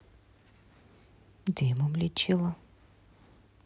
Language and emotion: Russian, neutral